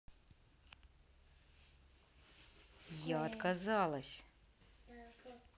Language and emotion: Russian, angry